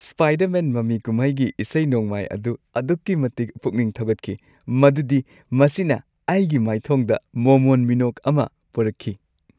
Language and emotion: Manipuri, happy